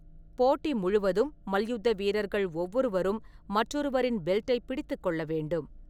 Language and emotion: Tamil, neutral